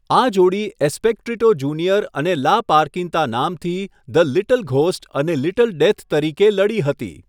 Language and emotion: Gujarati, neutral